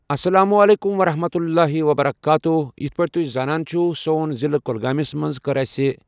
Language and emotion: Kashmiri, neutral